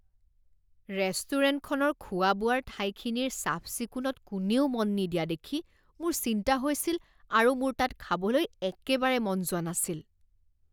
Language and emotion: Assamese, disgusted